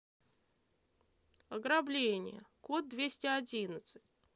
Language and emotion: Russian, neutral